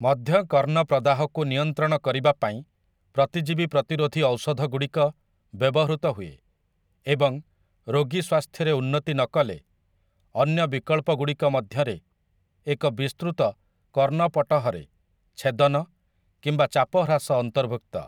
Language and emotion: Odia, neutral